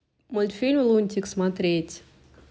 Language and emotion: Russian, neutral